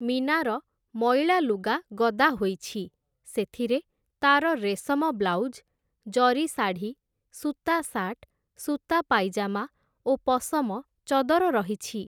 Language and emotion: Odia, neutral